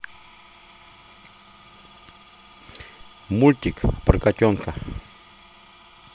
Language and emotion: Russian, neutral